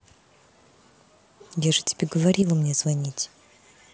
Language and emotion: Russian, angry